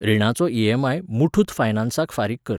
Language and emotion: Goan Konkani, neutral